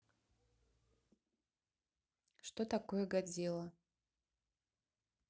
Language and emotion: Russian, neutral